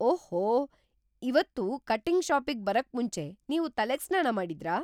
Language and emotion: Kannada, surprised